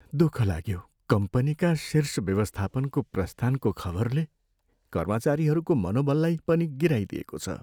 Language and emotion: Nepali, sad